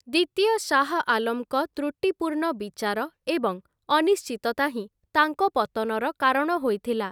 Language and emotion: Odia, neutral